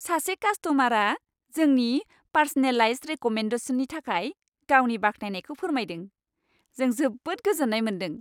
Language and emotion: Bodo, happy